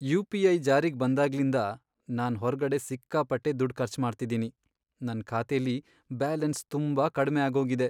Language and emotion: Kannada, sad